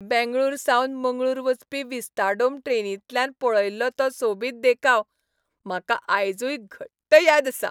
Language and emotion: Goan Konkani, happy